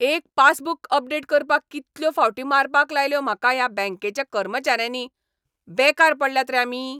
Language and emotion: Goan Konkani, angry